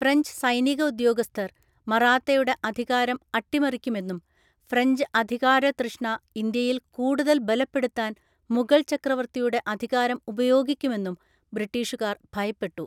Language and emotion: Malayalam, neutral